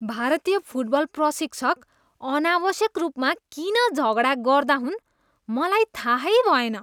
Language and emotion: Nepali, disgusted